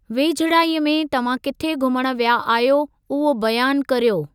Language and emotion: Sindhi, neutral